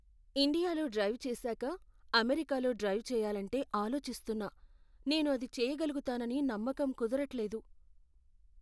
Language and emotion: Telugu, fearful